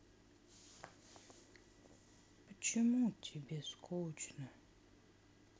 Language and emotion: Russian, sad